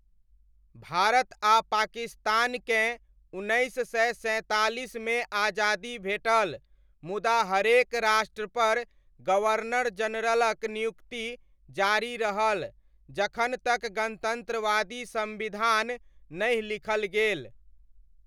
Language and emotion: Maithili, neutral